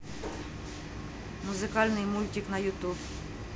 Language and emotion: Russian, neutral